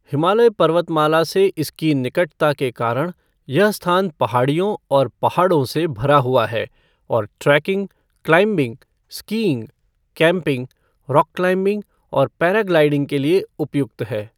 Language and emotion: Hindi, neutral